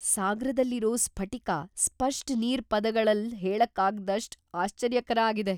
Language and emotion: Kannada, surprised